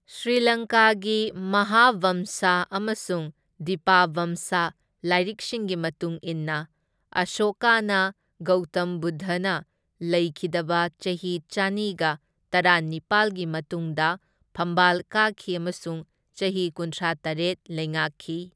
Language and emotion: Manipuri, neutral